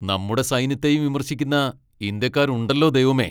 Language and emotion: Malayalam, angry